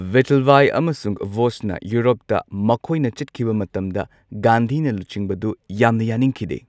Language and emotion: Manipuri, neutral